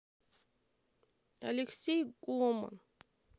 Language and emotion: Russian, sad